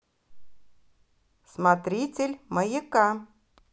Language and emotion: Russian, positive